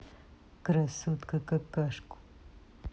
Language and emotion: Russian, angry